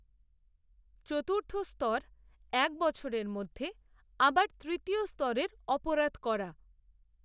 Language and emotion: Bengali, neutral